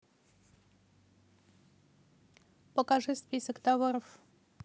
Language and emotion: Russian, neutral